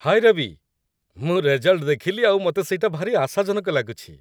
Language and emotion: Odia, happy